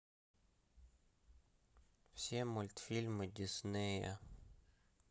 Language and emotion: Russian, neutral